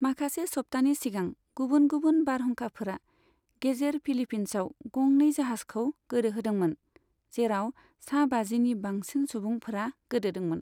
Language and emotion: Bodo, neutral